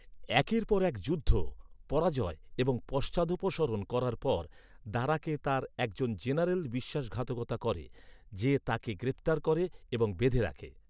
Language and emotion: Bengali, neutral